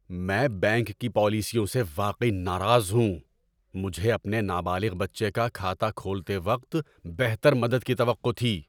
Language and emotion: Urdu, angry